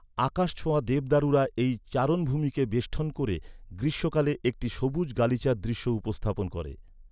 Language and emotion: Bengali, neutral